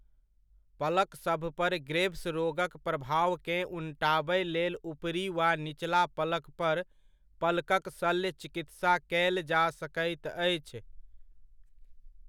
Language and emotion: Maithili, neutral